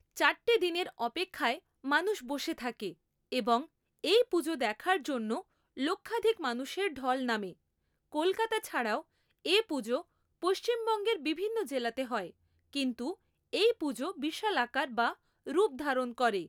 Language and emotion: Bengali, neutral